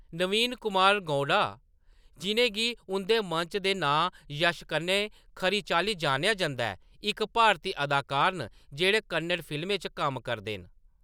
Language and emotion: Dogri, neutral